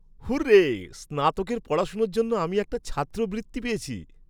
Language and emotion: Bengali, happy